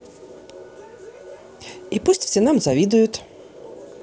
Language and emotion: Russian, positive